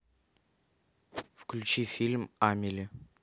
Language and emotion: Russian, neutral